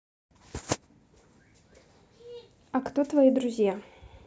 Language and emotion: Russian, neutral